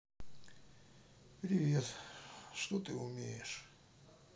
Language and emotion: Russian, sad